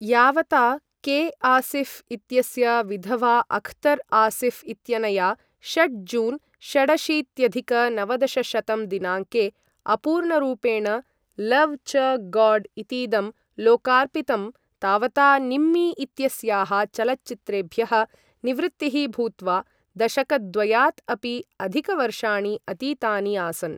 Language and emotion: Sanskrit, neutral